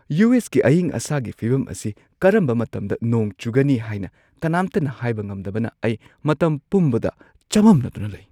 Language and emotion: Manipuri, surprised